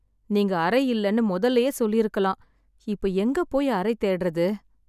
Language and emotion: Tamil, sad